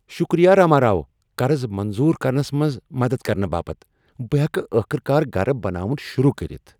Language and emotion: Kashmiri, happy